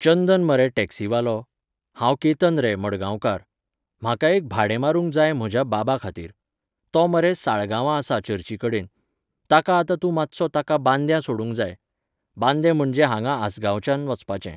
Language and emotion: Goan Konkani, neutral